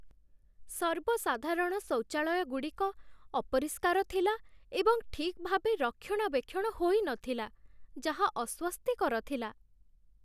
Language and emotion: Odia, sad